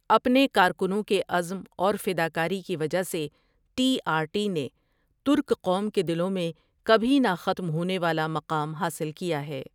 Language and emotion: Urdu, neutral